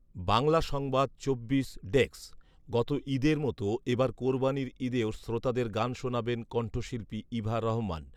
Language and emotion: Bengali, neutral